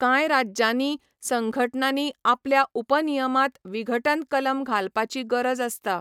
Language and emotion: Goan Konkani, neutral